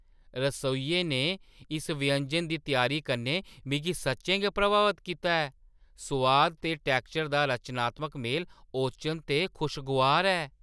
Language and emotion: Dogri, surprised